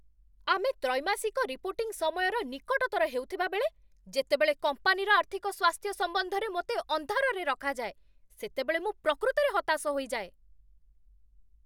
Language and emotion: Odia, angry